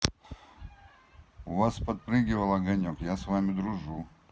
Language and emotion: Russian, neutral